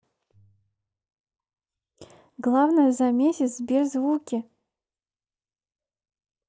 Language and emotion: Russian, neutral